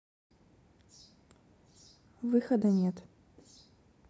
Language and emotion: Russian, neutral